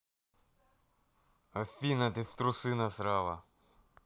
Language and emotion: Russian, angry